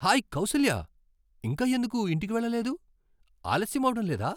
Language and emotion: Telugu, surprised